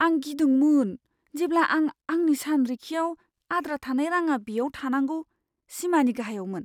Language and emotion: Bodo, fearful